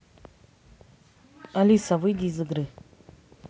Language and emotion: Russian, neutral